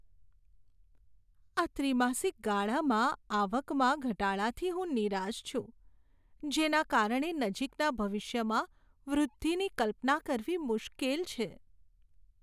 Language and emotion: Gujarati, sad